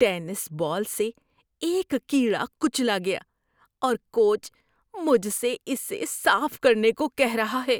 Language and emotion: Urdu, disgusted